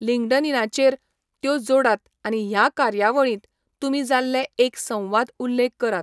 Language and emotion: Goan Konkani, neutral